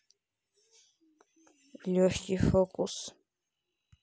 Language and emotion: Russian, neutral